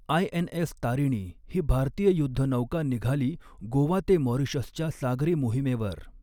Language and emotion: Marathi, neutral